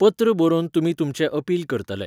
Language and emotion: Goan Konkani, neutral